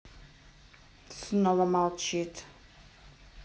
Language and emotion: Russian, neutral